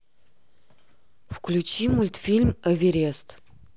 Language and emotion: Russian, neutral